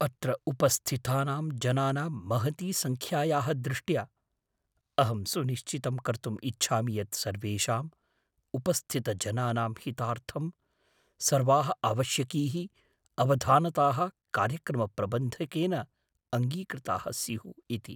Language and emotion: Sanskrit, fearful